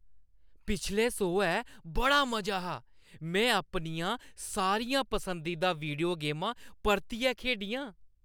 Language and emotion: Dogri, happy